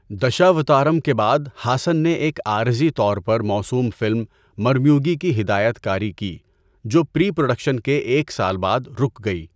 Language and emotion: Urdu, neutral